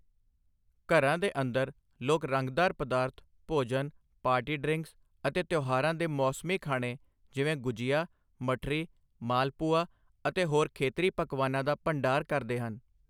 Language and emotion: Punjabi, neutral